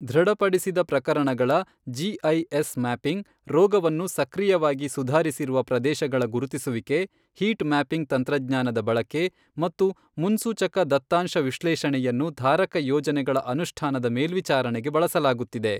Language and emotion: Kannada, neutral